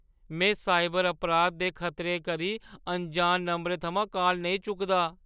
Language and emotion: Dogri, fearful